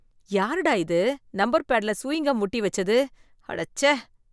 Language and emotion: Tamil, disgusted